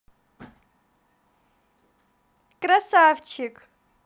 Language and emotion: Russian, positive